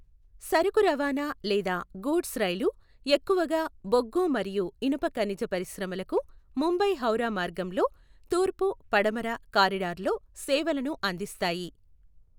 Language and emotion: Telugu, neutral